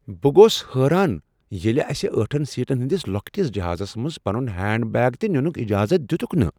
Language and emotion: Kashmiri, surprised